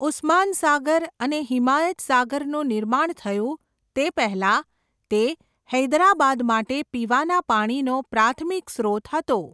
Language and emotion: Gujarati, neutral